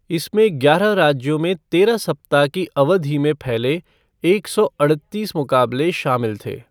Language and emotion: Hindi, neutral